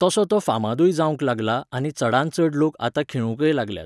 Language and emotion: Goan Konkani, neutral